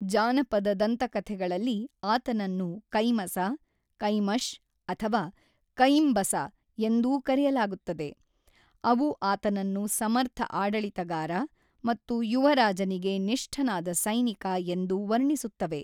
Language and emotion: Kannada, neutral